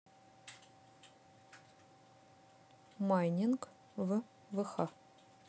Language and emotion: Russian, neutral